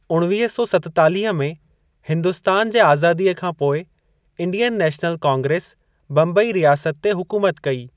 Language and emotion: Sindhi, neutral